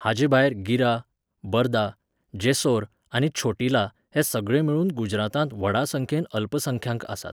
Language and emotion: Goan Konkani, neutral